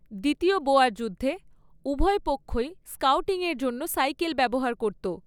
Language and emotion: Bengali, neutral